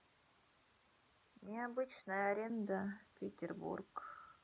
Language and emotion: Russian, sad